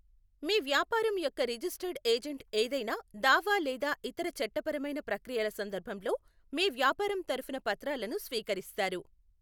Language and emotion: Telugu, neutral